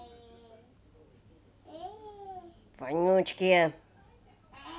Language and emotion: Russian, angry